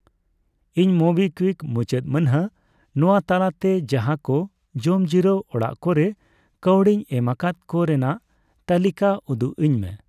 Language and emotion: Santali, neutral